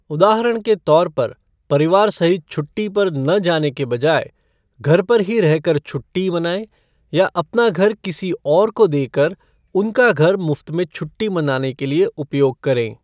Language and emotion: Hindi, neutral